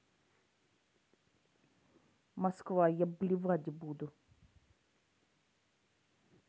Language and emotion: Russian, neutral